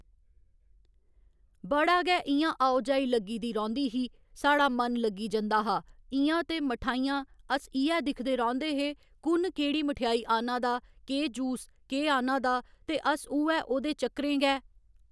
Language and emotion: Dogri, neutral